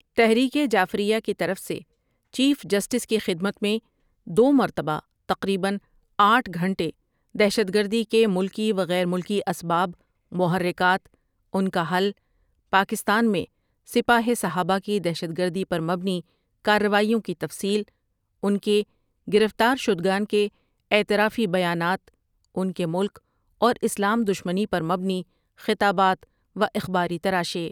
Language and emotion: Urdu, neutral